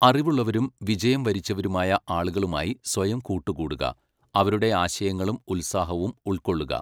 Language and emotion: Malayalam, neutral